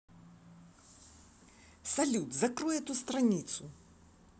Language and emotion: Russian, angry